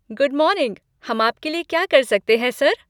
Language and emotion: Hindi, happy